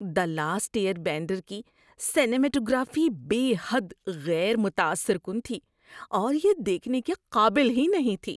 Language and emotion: Urdu, disgusted